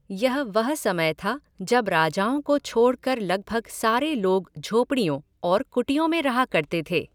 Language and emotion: Hindi, neutral